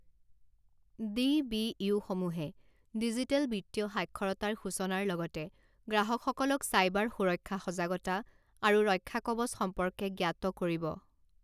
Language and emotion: Assamese, neutral